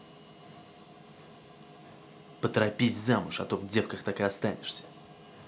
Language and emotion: Russian, angry